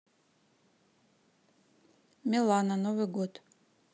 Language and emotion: Russian, neutral